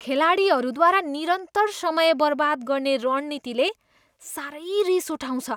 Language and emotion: Nepali, disgusted